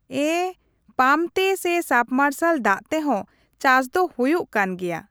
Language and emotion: Santali, neutral